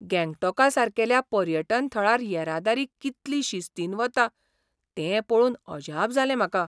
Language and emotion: Goan Konkani, surprised